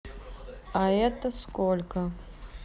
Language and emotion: Russian, neutral